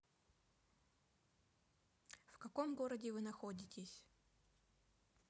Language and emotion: Russian, neutral